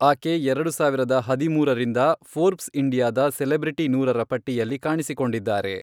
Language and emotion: Kannada, neutral